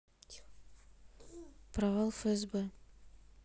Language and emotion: Russian, neutral